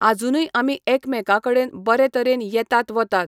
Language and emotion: Goan Konkani, neutral